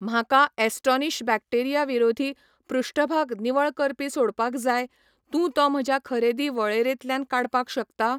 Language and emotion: Goan Konkani, neutral